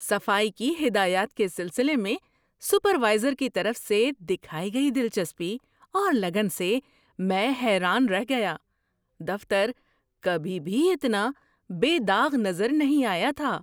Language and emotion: Urdu, surprised